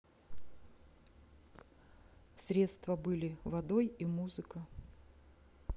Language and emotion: Russian, neutral